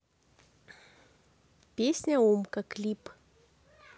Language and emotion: Russian, neutral